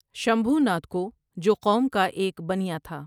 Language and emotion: Urdu, neutral